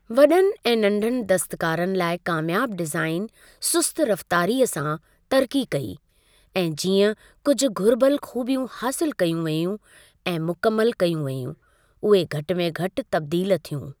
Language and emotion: Sindhi, neutral